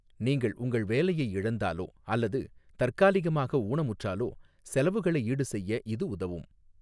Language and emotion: Tamil, neutral